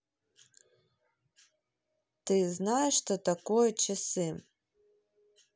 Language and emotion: Russian, neutral